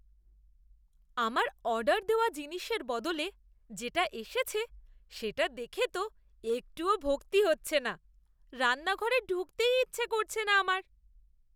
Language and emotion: Bengali, disgusted